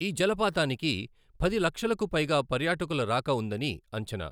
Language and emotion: Telugu, neutral